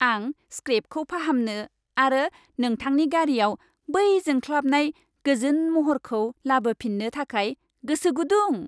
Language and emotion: Bodo, happy